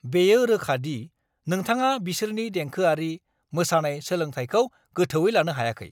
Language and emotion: Bodo, angry